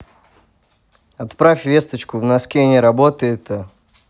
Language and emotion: Russian, neutral